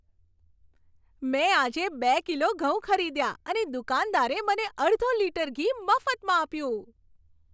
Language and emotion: Gujarati, happy